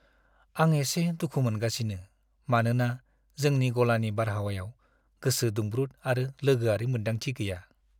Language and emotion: Bodo, sad